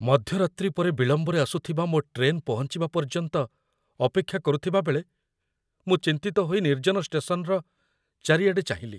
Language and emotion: Odia, fearful